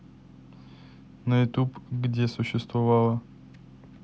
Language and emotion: Russian, neutral